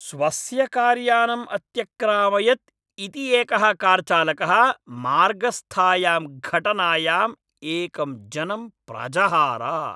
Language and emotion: Sanskrit, angry